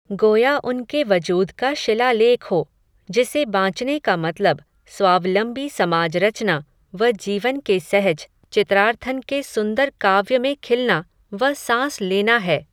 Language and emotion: Hindi, neutral